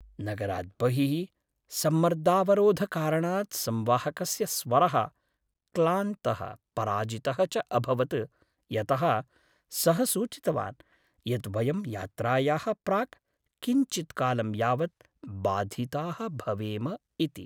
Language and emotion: Sanskrit, sad